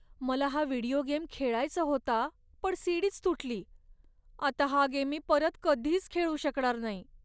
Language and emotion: Marathi, sad